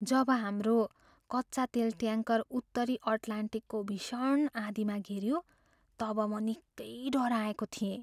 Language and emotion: Nepali, fearful